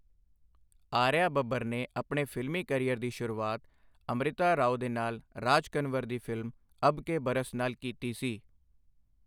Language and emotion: Punjabi, neutral